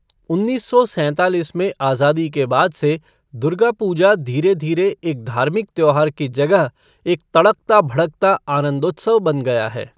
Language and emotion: Hindi, neutral